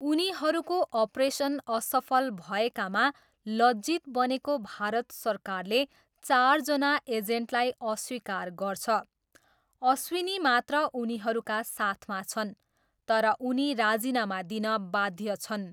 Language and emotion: Nepali, neutral